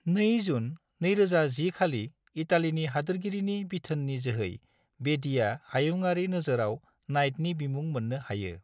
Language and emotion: Bodo, neutral